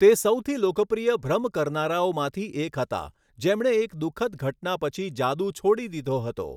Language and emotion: Gujarati, neutral